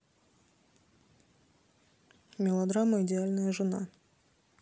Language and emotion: Russian, neutral